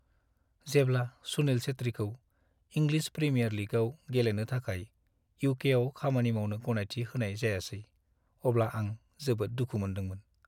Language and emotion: Bodo, sad